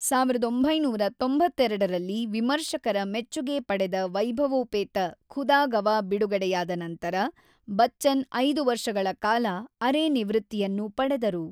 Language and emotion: Kannada, neutral